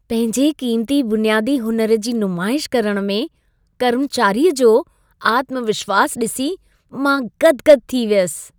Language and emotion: Sindhi, happy